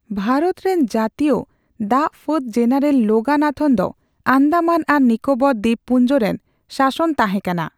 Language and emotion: Santali, neutral